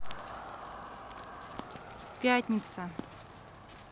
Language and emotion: Russian, neutral